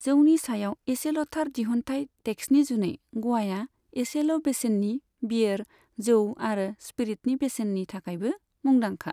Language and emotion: Bodo, neutral